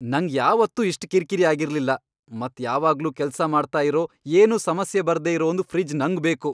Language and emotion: Kannada, angry